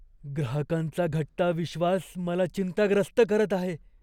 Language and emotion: Marathi, fearful